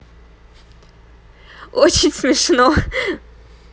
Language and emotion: Russian, positive